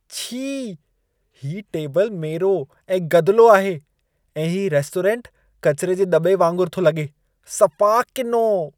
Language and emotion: Sindhi, disgusted